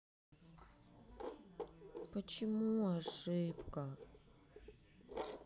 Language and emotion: Russian, sad